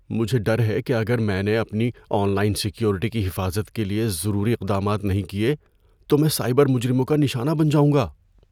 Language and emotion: Urdu, fearful